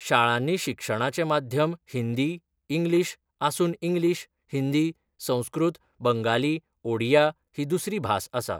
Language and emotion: Goan Konkani, neutral